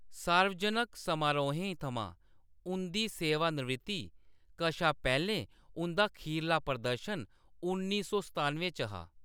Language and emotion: Dogri, neutral